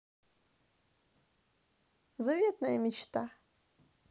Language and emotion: Russian, positive